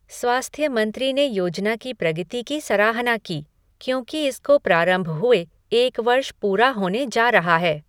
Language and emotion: Hindi, neutral